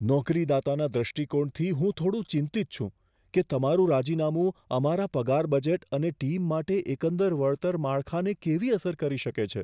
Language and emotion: Gujarati, fearful